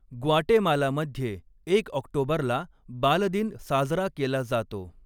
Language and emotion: Marathi, neutral